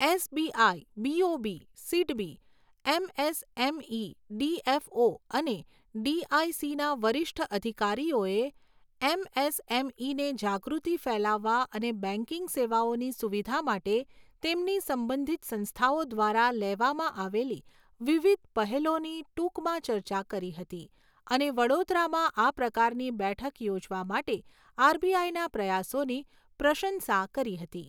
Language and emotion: Gujarati, neutral